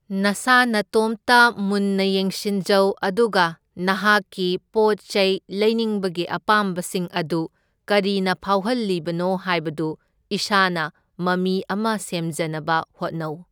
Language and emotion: Manipuri, neutral